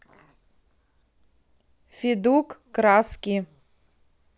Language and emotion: Russian, neutral